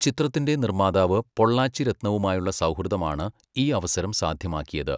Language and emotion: Malayalam, neutral